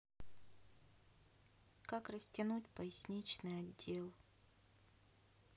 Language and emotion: Russian, sad